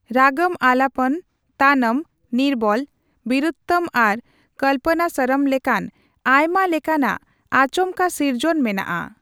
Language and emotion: Santali, neutral